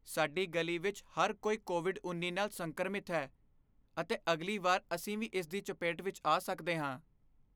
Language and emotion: Punjabi, fearful